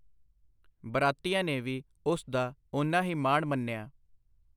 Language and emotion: Punjabi, neutral